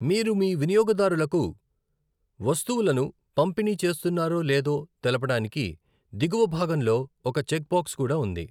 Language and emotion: Telugu, neutral